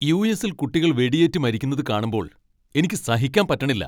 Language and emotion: Malayalam, angry